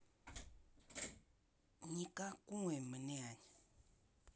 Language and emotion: Russian, angry